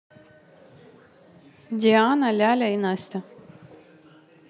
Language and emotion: Russian, neutral